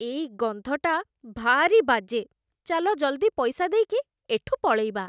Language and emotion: Odia, disgusted